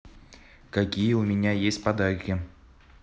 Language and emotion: Russian, neutral